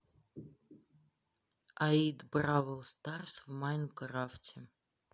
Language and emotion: Russian, neutral